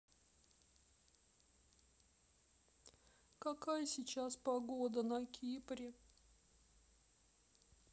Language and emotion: Russian, sad